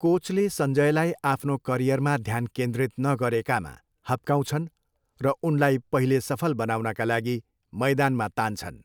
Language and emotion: Nepali, neutral